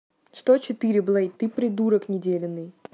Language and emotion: Russian, angry